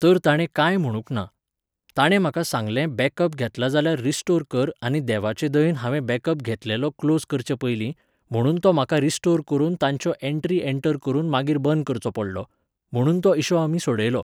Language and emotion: Goan Konkani, neutral